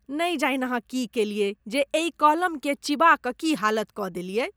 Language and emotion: Maithili, disgusted